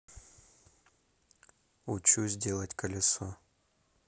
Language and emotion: Russian, neutral